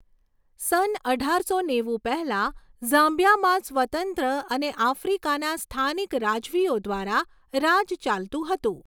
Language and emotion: Gujarati, neutral